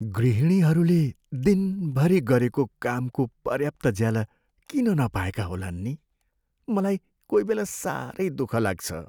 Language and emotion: Nepali, sad